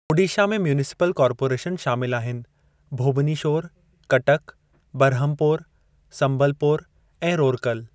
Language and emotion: Sindhi, neutral